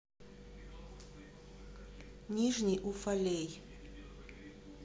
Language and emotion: Russian, neutral